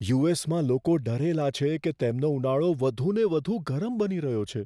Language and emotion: Gujarati, fearful